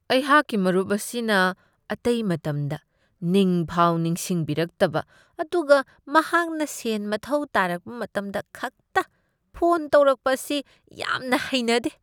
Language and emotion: Manipuri, disgusted